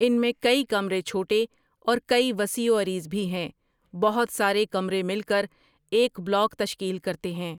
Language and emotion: Urdu, neutral